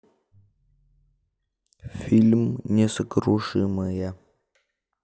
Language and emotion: Russian, neutral